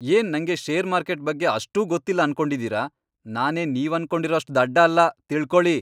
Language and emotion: Kannada, angry